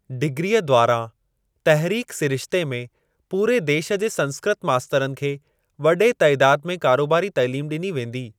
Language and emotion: Sindhi, neutral